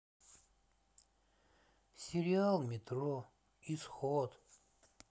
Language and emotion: Russian, sad